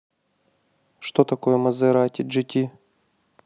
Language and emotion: Russian, neutral